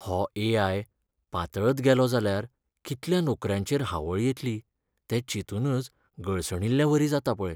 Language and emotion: Goan Konkani, sad